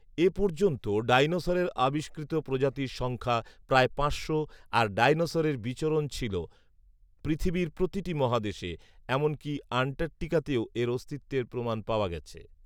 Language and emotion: Bengali, neutral